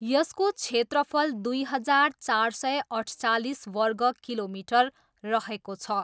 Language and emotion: Nepali, neutral